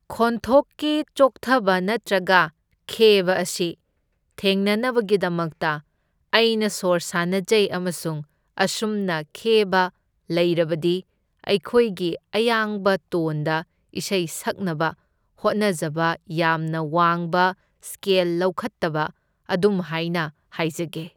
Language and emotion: Manipuri, neutral